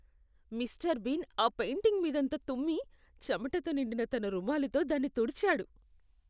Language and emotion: Telugu, disgusted